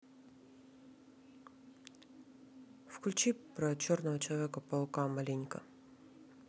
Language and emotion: Russian, neutral